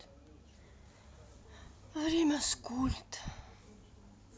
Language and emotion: Russian, sad